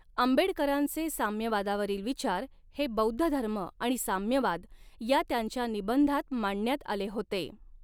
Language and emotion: Marathi, neutral